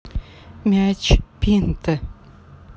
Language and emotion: Russian, neutral